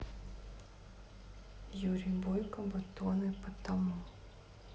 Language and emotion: Russian, neutral